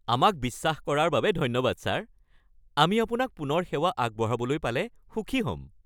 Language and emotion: Assamese, happy